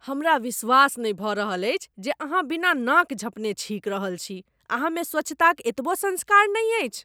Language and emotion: Maithili, disgusted